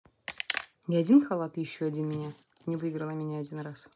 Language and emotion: Russian, neutral